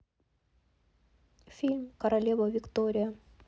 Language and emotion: Russian, neutral